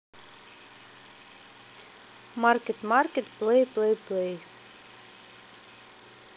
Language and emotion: Russian, neutral